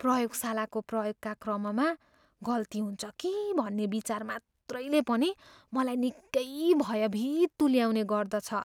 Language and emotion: Nepali, fearful